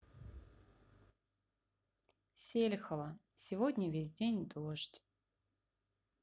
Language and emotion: Russian, sad